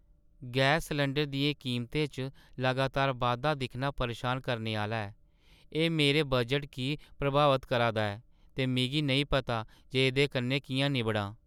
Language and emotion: Dogri, sad